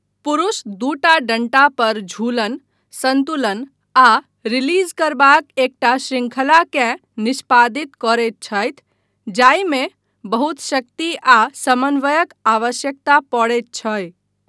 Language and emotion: Maithili, neutral